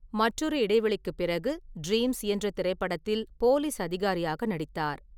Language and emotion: Tamil, neutral